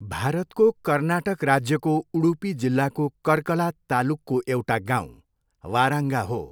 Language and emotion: Nepali, neutral